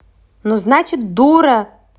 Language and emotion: Russian, angry